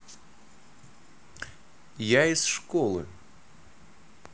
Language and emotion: Russian, neutral